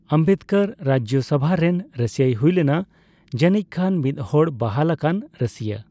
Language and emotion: Santali, neutral